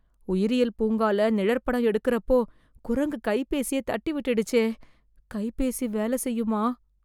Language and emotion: Tamil, fearful